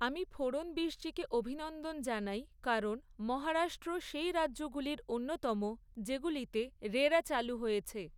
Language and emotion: Bengali, neutral